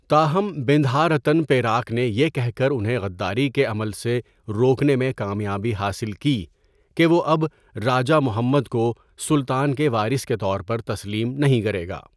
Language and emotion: Urdu, neutral